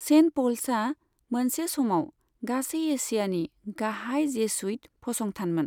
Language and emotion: Bodo, neutral